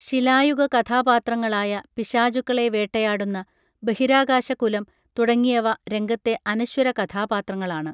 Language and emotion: Malayalam, neutral